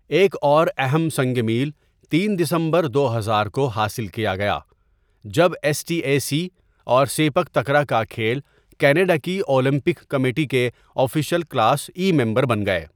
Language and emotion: Urdu, neutral